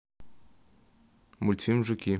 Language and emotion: Russian, neutral